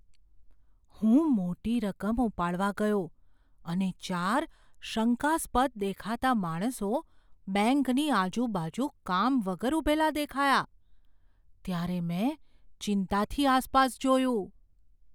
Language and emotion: Gujarati, fearful